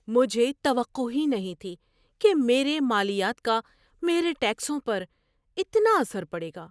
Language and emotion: Urdu, surprised